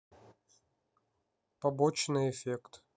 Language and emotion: Russian, neutral